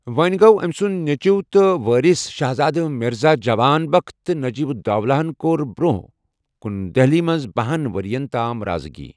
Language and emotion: Kashmiri, neutral